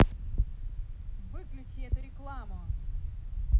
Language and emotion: Russian, angry